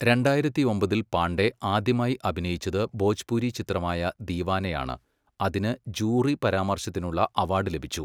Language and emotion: Malayalam, neutral